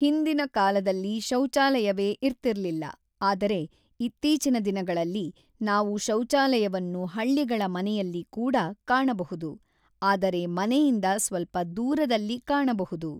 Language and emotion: Kannada, neutral